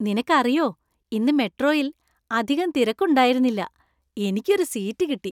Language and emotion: Malayalam, happy